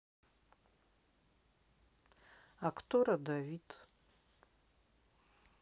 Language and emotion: Russian, neutral